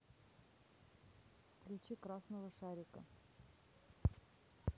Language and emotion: Russian, neutral